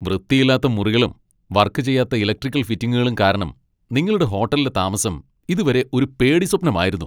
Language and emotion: Malayalam, angry